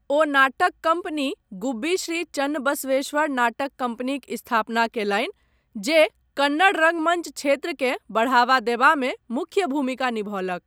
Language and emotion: Maithili, neutral